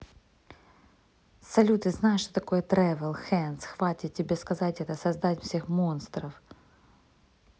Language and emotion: Russian, neutral